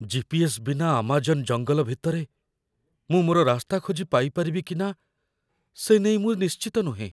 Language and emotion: Odia, fearful